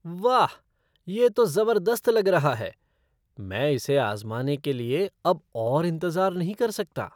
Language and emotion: Hindi, surprised